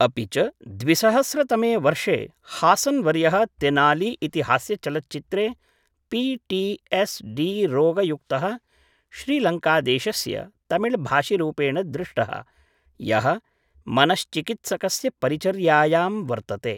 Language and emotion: Sanskrit, neutral